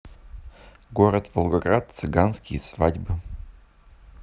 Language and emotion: Russian, neutral